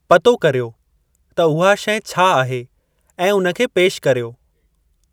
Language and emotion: Sindhi, neutral